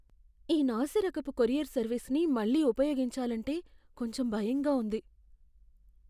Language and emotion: Telugu, fearful